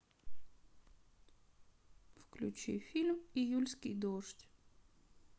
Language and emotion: Russian, sad